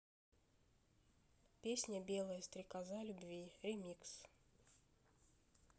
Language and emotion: Russian, neutral